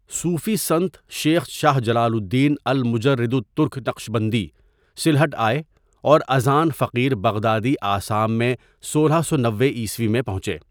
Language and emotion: Urdu, neutral